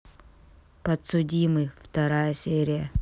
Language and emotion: Russian, neutral